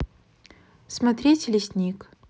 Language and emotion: Russian, neutral